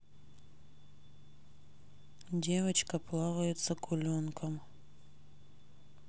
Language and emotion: Russian, neutral